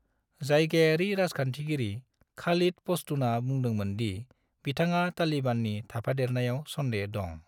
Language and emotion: Bodo, neutral